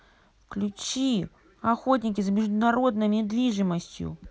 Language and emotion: Russian, angry